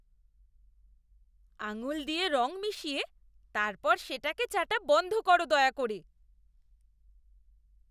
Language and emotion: Bengali, disgusted